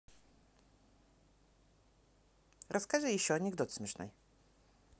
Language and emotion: Russian, neutral